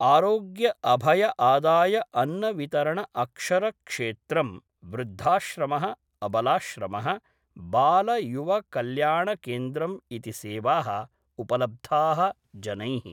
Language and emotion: Sanskrit, neutral